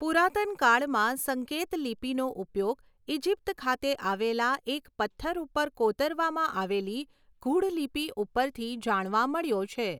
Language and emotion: Gujarati, neutral